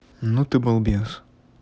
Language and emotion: Russian, neutral